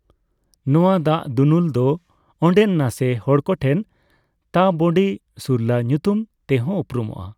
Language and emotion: Santali, neutral